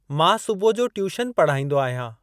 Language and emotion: Sindhi, neutral